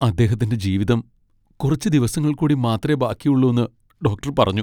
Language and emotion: Malayalam, sad